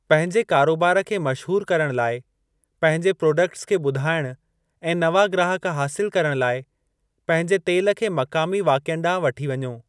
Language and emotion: Sindhi, neutral